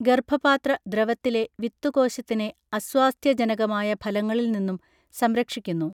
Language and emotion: Malayalam, neutral